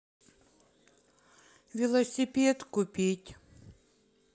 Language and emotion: Russian, sad